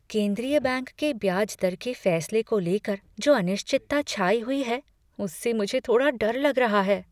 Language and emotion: Hindi, fearful